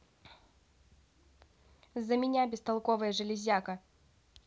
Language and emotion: Russian, angry